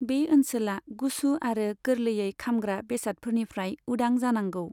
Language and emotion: Bodo, neutral